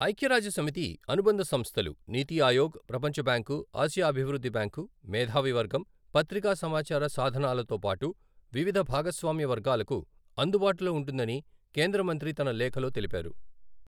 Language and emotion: Telugu, neutral